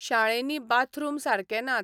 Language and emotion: Goan Konkani, neutral